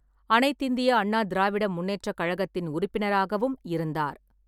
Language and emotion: Tamil, neutral